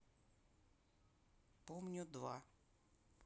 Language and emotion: Russian, neutral